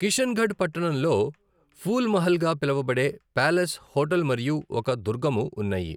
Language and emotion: Telugu, neutral